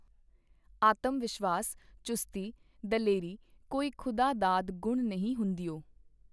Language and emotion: Punjabi, neutral